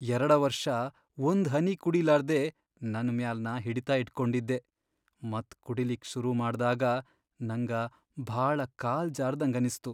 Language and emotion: Kannada, sad